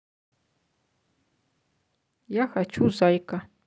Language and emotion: Russian, neutral